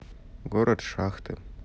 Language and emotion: Russian, neutral